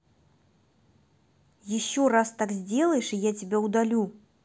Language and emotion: Russian, angry